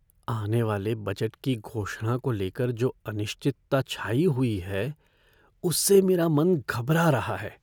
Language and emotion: Hindi, fearful